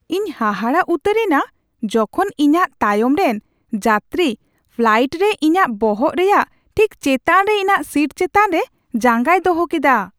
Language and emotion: Santali, surprised